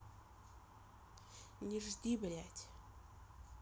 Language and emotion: Russian, angry